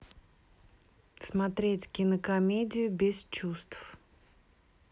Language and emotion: Russian, neutral